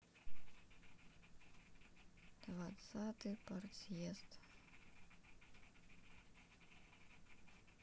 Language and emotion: Russian, sad